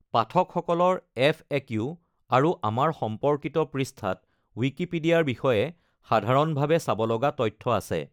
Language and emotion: Assamese, neutral